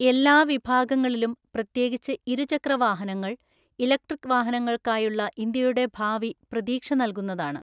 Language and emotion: Malayalam, neutral